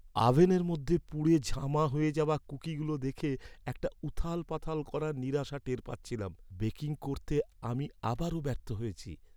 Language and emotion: Bengali, sad